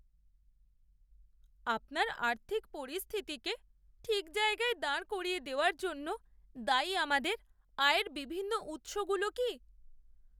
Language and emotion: Bengali, sad